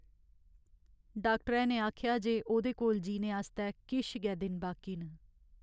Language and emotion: Dogri, sad